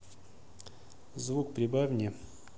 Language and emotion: Russian, neutral